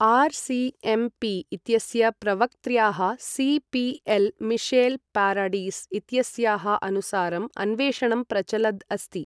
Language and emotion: Sanskrit, neutral